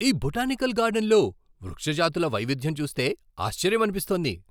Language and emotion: Telugu, surprised